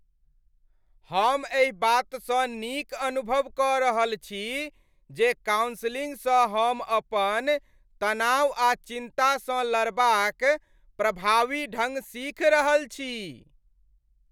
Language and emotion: Maithili, happy